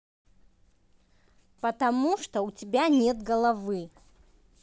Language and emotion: Russian, angry